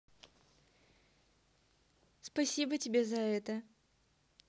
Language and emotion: Russian, positive